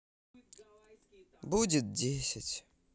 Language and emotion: Russian, sad